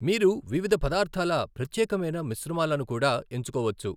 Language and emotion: Telugu, neutral